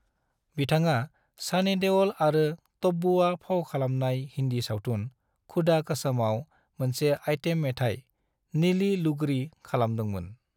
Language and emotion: Bodo, neutral